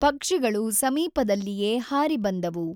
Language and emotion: Kannada, neutral